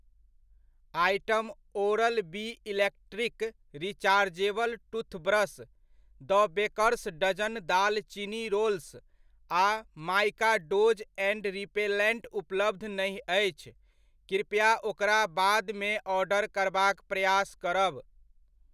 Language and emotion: Maithili, neutral